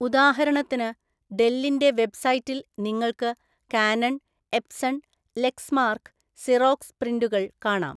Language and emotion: Malayalam, neutral